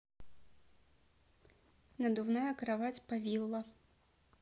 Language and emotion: Russian, neutral